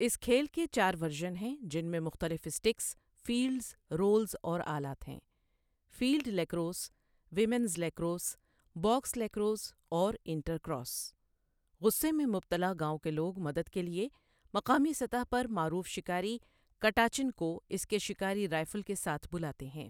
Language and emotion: Urdu, neutral